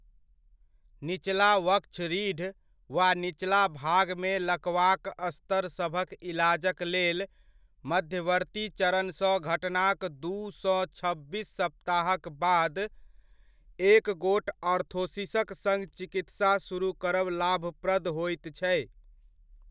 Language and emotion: Maithili, neutral